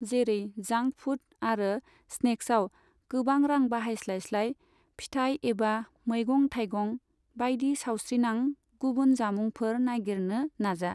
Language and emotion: Bodo, neutral